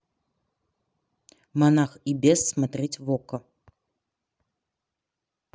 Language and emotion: Russian, neutral